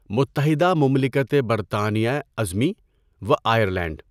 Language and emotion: Urdu, neutral